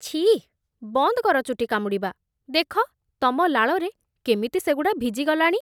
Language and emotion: Odia, disgusted